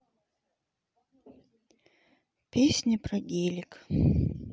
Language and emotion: Russian, sad